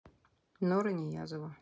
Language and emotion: Russian, neutral